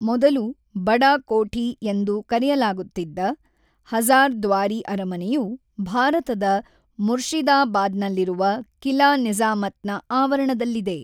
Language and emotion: Kannada, neutral